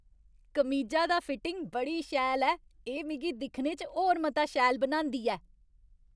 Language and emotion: Dogri, happy